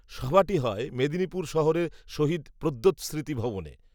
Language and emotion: Bengali, neutral